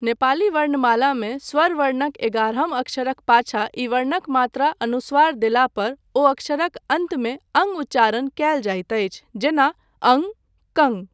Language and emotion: Maithili, neutral